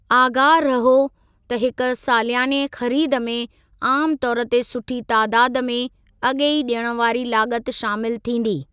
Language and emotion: Sindhi, neutral